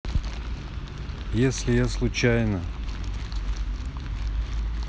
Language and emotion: Russian, neutral